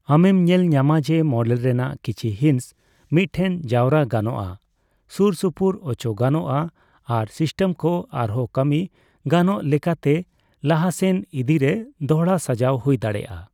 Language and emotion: Santali, neutral